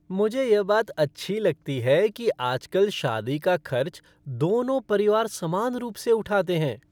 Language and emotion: Hindi, happy